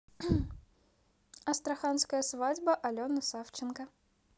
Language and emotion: Russian, neutral